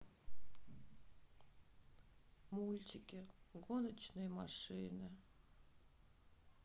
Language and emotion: Russian, sad